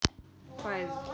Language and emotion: Russian, neutral